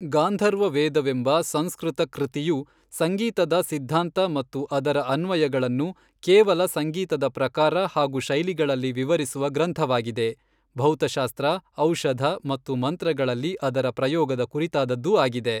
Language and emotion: Kannada, neutral